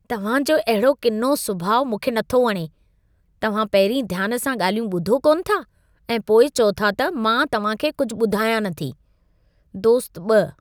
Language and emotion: Sindhi, disgusted